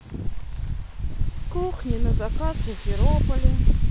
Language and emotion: Russian, sad